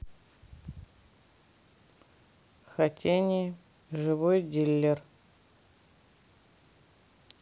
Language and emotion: Russian, neutral